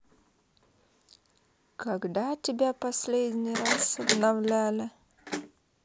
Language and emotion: Russian, neutral